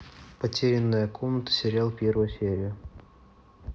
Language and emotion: Russian, neutral